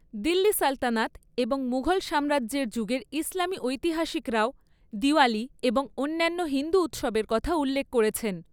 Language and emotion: Bengali, neutral